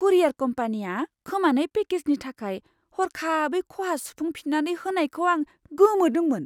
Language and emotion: Bodo, surprised